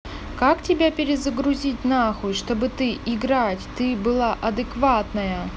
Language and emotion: Russian, neutral